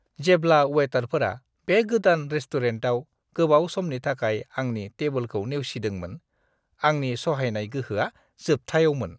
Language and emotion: Bodo, disgusted